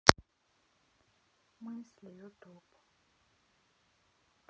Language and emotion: Russian, sad